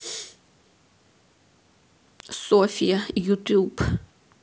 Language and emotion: Russian, sad